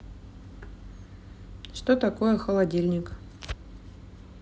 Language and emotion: Russian, neutral